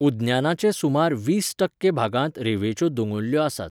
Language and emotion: Goan Konkani, neutral